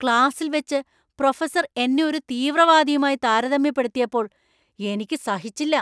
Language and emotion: Malayalam, angry